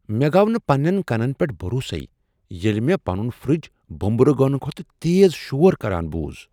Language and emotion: Kashmiri, surprised